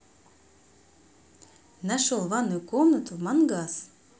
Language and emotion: Russian, positive